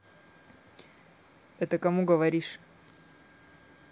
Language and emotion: Russian, neutral